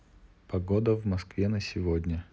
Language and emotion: Russian, neutral